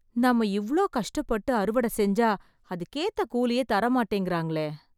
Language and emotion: Tamil, sad